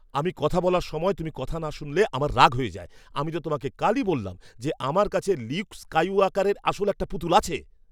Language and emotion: Bengali, angry